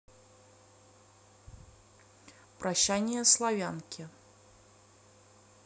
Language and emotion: Russian, neutral